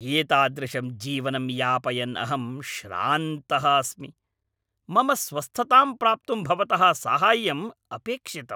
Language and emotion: Sanskrit, angry